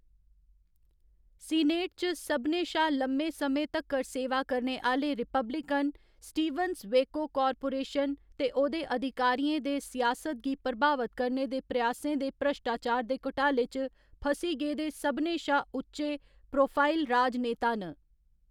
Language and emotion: Dogri, neutral